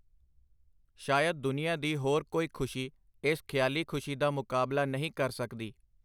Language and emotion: Punjabi, neutral